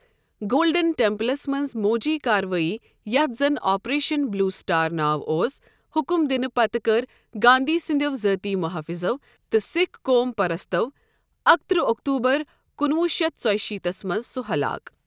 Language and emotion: Kashmiri, neutral